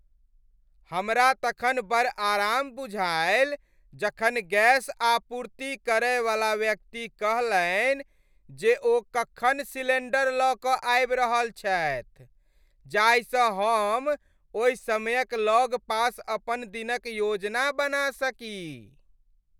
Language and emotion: Maithili, happy